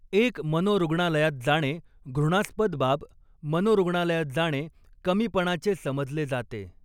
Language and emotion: Marathi, neutral